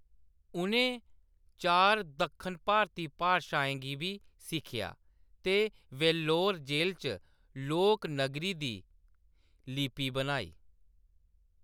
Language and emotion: Dogri, neutral